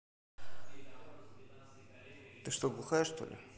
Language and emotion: Russian, angry